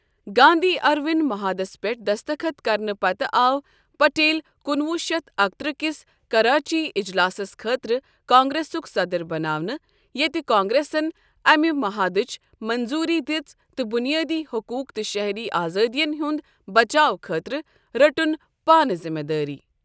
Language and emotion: Kashmiri, neutral